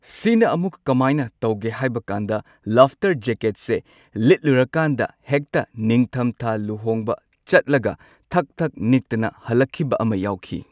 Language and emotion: Manipuri, neutral